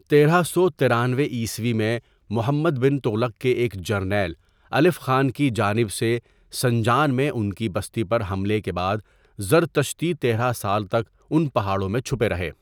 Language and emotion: Urdu, neutral